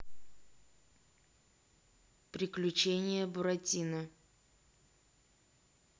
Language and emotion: Russian, neutral